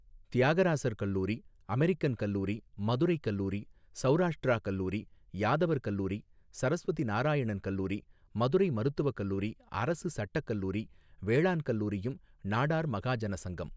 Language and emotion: Tamil, neutral